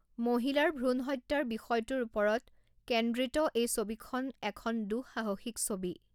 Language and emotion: Assamese, neutral